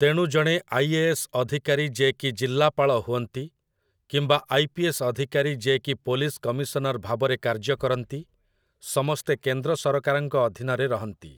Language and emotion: Odia, neutral